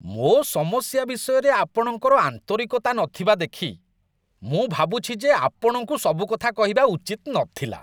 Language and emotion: Odia, disgusted